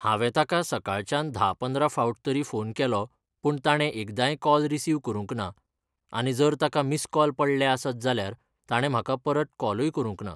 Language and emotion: Goan Konkani, neutral